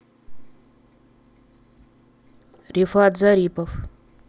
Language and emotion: Russian, neutral